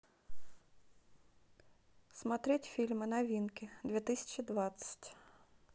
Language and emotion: Russian, neutral